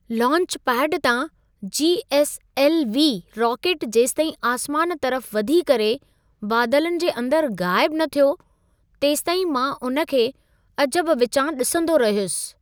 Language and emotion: Sindhi, surprised